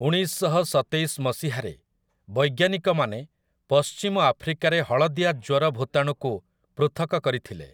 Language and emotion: Odia, neutral